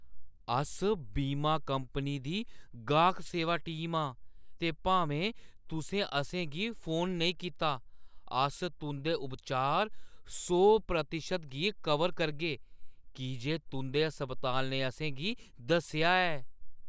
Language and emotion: Dogri, surprised